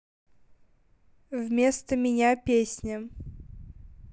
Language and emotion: Russian, neutral